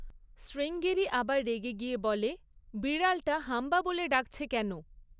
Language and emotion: Bengali, neutral